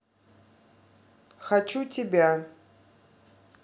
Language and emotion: Russian, neutral